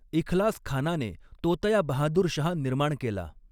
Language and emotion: Marathi, neutral